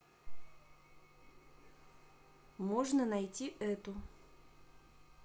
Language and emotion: Russian, neutral